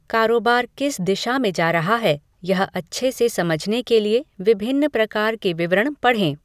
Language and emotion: Hindi, neutral